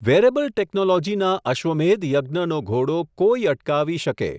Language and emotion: Gujarati, neutral